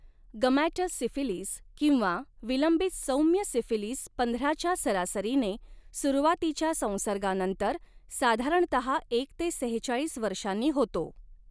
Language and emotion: Marathi, neutral